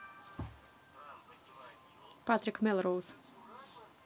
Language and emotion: Russian, neutral